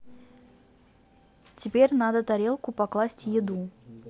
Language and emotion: Russian, neutral